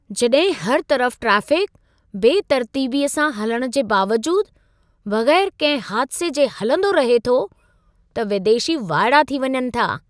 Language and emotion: Sindhi, surprised